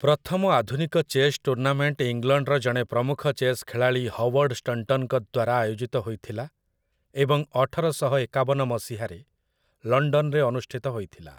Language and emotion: Odia, neutral